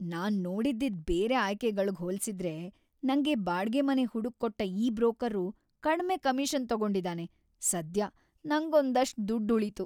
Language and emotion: Kannada, happy